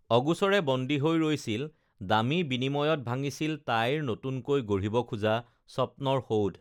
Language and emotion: Assamese, neutral